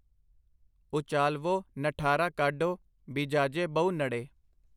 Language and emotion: Punjabi, neutral